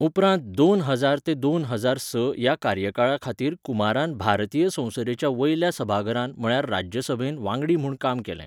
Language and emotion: Goan Konkani, neutral